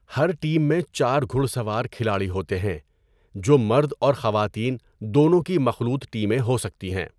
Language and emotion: Urdu, neutral